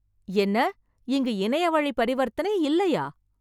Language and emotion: Tamil, surprised